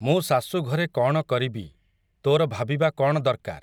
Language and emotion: Odia, neutral